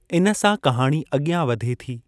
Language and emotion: Sindhi, neutral